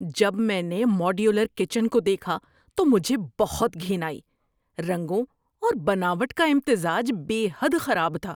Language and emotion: Urdu, disgusted